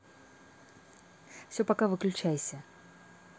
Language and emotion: Russian, neutral